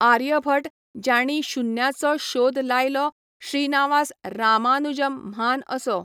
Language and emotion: Goan Konkani, neutral